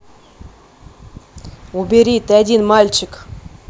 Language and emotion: Russian, angry